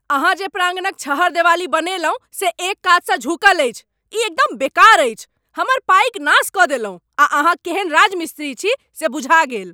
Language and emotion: Maithili, angry